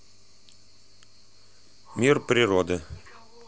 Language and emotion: Russian, neutral